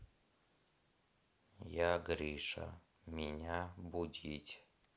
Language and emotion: Russian, sad